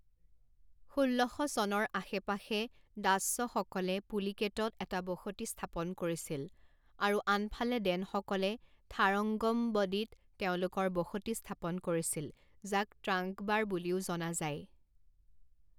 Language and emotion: Assamese, neutral